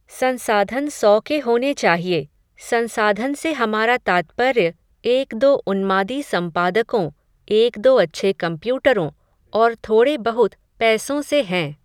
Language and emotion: Hindi, neutral